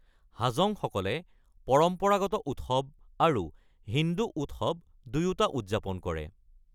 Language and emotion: Assamese, neutral